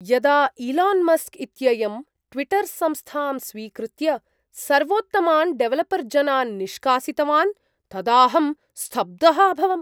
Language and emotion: Sanskrit, surprised